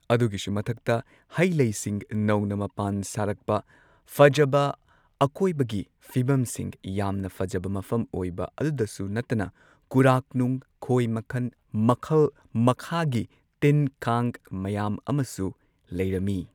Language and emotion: Manipuri, neutral